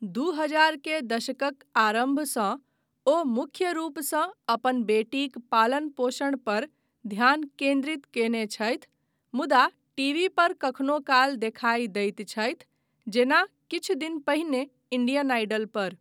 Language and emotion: Maithili, neutral